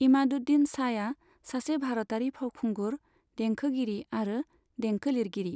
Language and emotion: Bodo, neutral